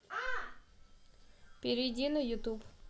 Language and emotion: Russian, neutral